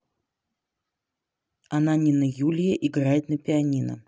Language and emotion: Russian, neutral